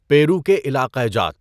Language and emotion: Urdu, neutral